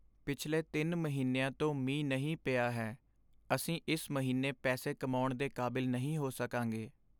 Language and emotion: Punjabi, sad